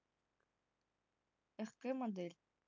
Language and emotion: Russian, neutral